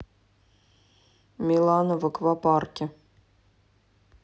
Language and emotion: Russian, neutral